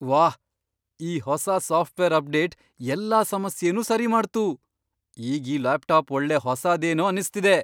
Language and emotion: Kannada, surprised